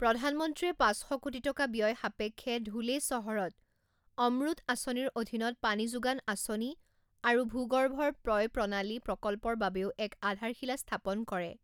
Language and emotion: Assamese, neutral